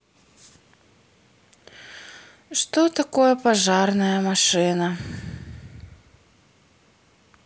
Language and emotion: Russian, sad